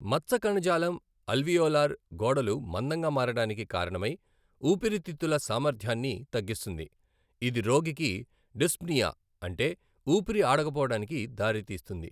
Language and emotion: Telugu, neutral